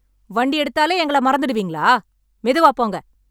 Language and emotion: Tamil, angry